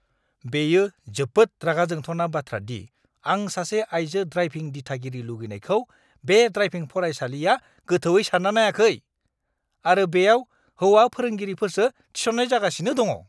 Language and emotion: Bodo, angry